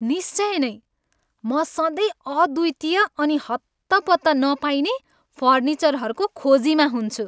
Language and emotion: Nepali, happy